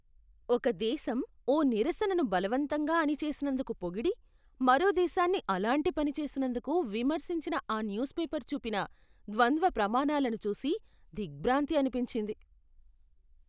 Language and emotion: Telugu, disgusted